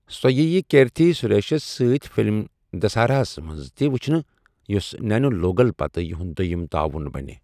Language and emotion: Kashmiri, neutral